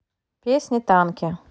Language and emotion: Russian, neutral